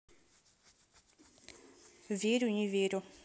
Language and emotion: Russian, neutral